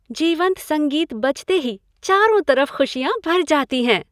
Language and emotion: Hindi, happy